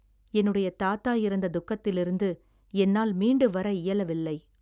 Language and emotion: Tamil, sad